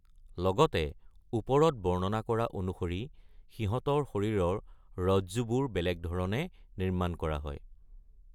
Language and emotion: Assamese, neutral